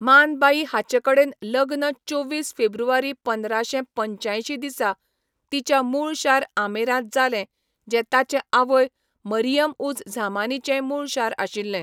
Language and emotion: Goan Konkani, neutral